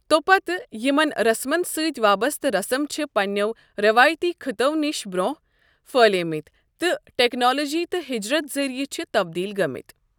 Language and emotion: Kashmiri, neutral